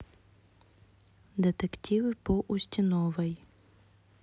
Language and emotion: Russian, neutral